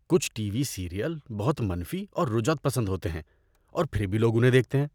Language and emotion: Urdu, disgusted